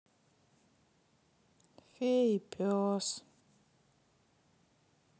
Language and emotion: Russian, sad